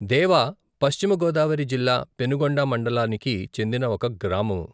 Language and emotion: Telugu, neutral